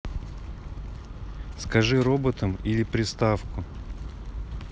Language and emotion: Russian, neutral